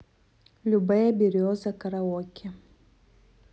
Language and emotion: Russian, neutral